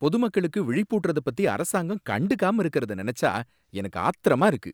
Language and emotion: Tamil, angry